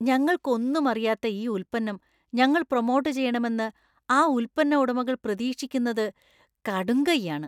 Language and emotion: Malayalam, disgusted